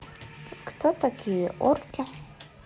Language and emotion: Russian, neutral